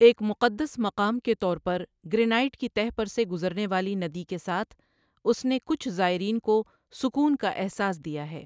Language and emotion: Urdu, neutral